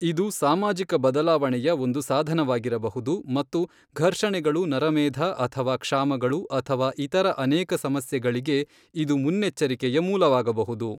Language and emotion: Kannada, neutral